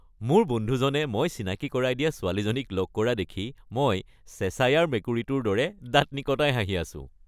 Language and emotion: Assamese, happy